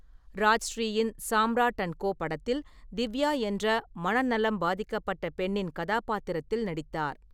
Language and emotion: Tamil, neutral